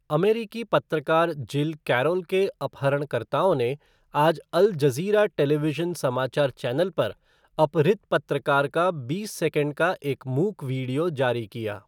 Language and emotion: Hindi, neutral